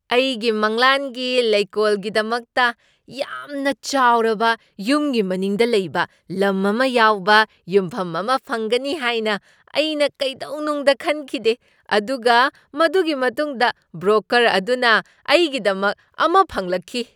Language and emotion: Manipuri, surprised